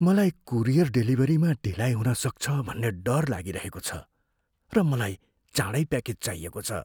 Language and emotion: Nepali, fearful